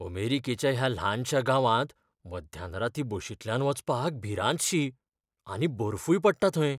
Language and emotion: Goan Konkani, fearful